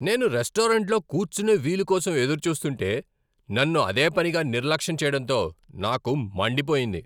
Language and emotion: Telugu, angry